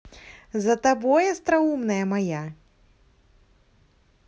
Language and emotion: Russian, positive